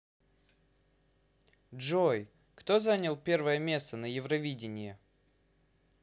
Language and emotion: Russian, neutral